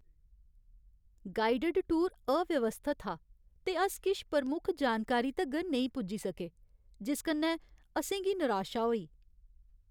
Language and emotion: Dogri, sad